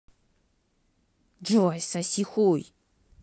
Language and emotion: Russian, angry